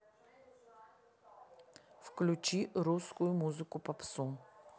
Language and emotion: Russian, neutral